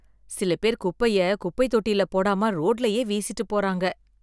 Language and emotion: Tamil, disgusted